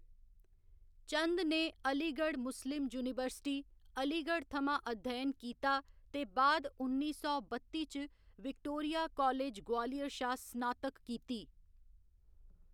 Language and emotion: Dogri, neutral